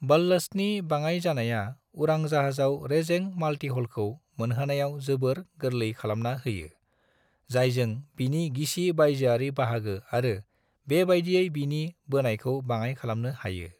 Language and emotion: Bodo, neutral